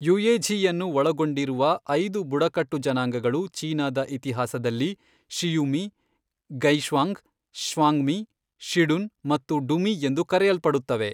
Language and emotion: Kannada, neutral